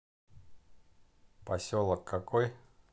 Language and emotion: Russian, neutral